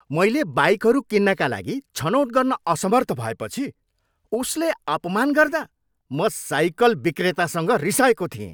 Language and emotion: Nepali, angry